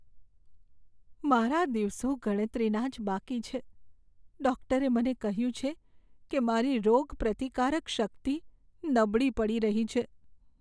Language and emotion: Gujarati, sad